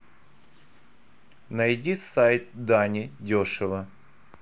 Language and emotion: Russian, neutral